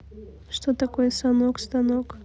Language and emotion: Russian, neutral